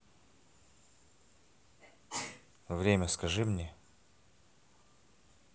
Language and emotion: Russian, neutral